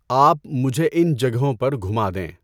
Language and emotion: Urdu, neutral